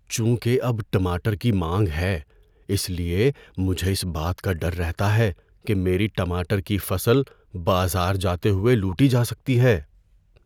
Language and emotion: Urdu, fearful